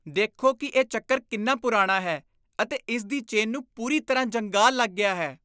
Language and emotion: Punjabi, disgusted